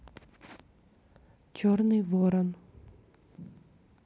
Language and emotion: Russian, neutral